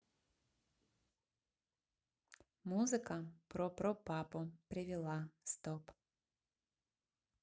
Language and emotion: Russian, neutral